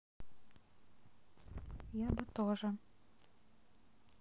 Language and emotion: Russian, sad